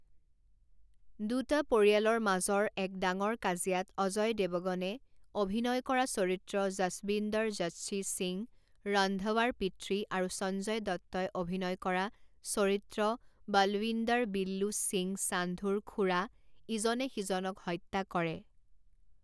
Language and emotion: Assamese, neutral